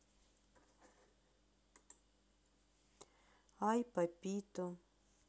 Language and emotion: Russian, sad